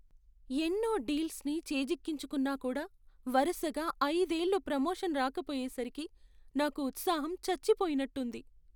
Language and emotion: Telugu, sad